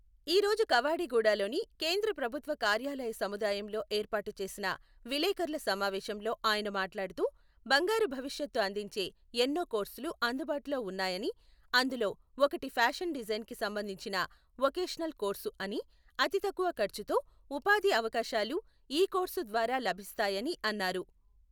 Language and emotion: Telugu, neutral